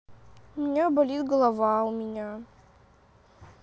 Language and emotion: Russian, sad